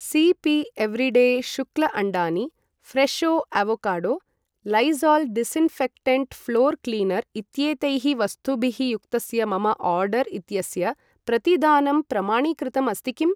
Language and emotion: Sanskrit, neutral